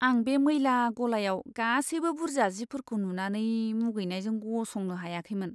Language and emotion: Bodo, disgusted